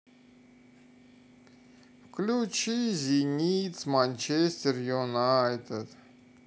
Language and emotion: Russian, sad